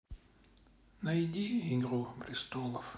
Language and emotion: Russian, sad